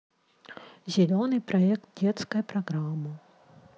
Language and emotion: Russian, neutral